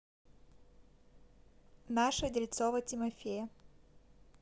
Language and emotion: Russian, neutral